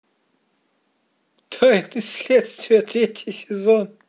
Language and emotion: Russian, positive